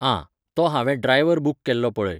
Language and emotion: Goan Konkani, neutral